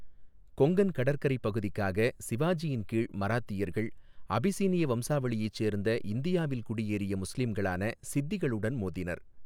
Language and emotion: Tamil, neutral